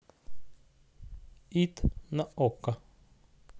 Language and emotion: Russian, neutral